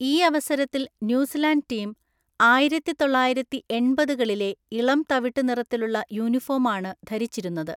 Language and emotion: Malayalam, neutral